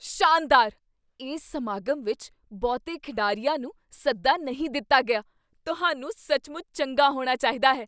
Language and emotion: Punjabi, surprised